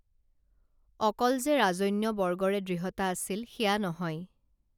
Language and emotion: Assamese, neutral